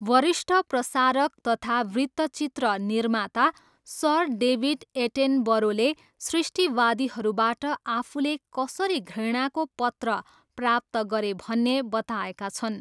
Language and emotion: Nepali, neutral